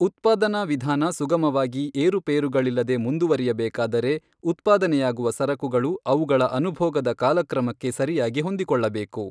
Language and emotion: Kannada, neutral